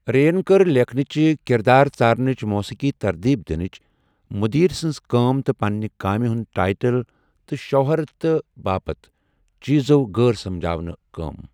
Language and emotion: Kashmiri, neutral